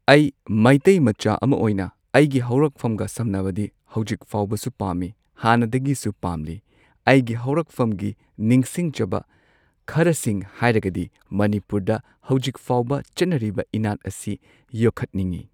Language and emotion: Manipuri, neutral